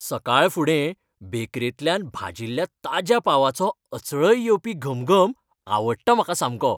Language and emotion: Goan Konkani, happy